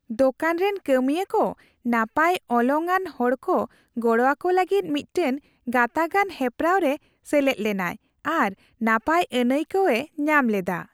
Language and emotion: Santali, happy